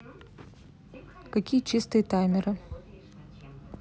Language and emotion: Russian, neutral